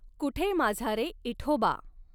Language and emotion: Marathi, neutral